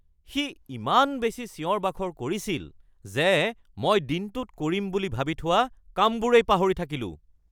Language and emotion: Assamese, angry